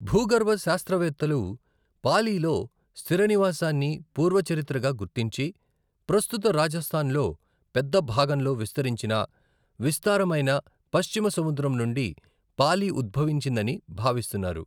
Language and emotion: Telugu, neutral